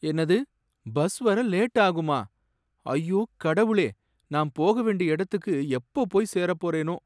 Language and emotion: Tamil, sad